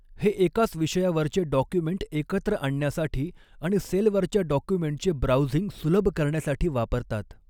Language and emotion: Marathi, neutral